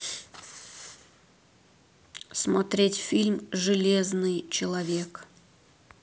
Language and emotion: Russian, neutral